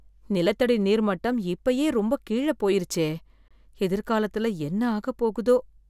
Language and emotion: Tamil, fearful